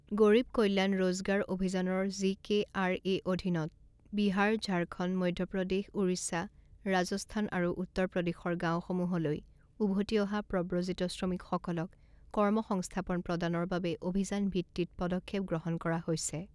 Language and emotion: Assamese, neutral